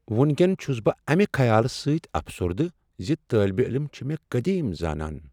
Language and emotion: Kashmiri, sad